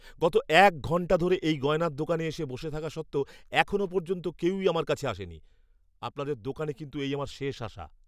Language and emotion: Bengali, angry